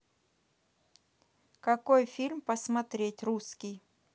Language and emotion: Russian, neutral